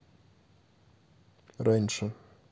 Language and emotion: Russian, neutral